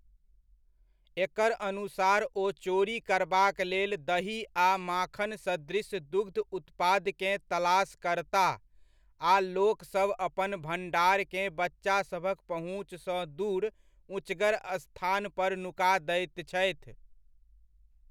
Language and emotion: Maithili, neutral